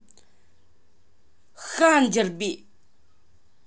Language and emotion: Russian, angry